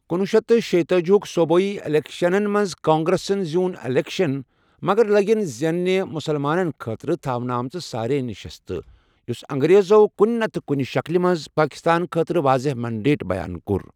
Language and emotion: Kashmiri, neutral